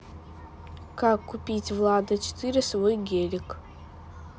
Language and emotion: Russian, neutral